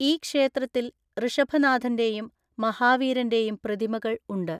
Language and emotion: Malayalam, neutral